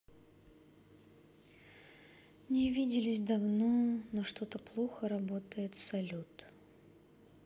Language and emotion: Russian, sad